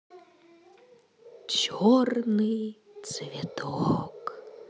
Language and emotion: Russian, positive